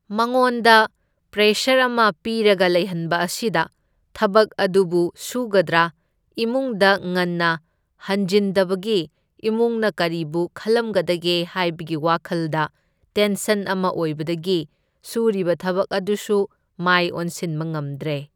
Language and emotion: Manipuri, neutral